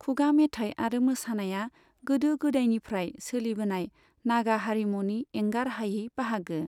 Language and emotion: Bodo, neutral